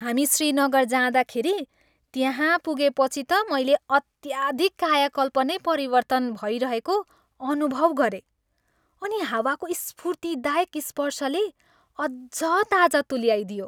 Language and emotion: Nepali, happy